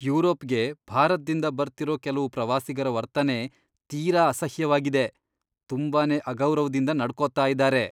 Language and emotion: Kannada, disgusted